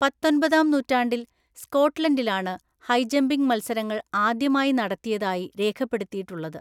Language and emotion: Malayalam, neutral